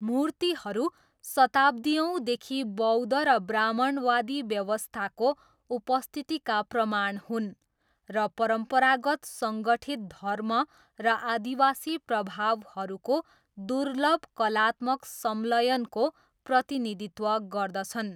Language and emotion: Nepali, neutral